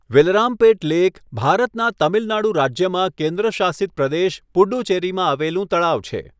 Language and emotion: Gujarati, neutral